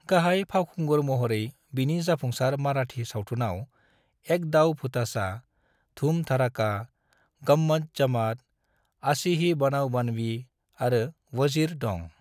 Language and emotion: Bodo, neutral